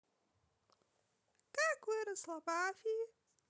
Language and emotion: Russian, positive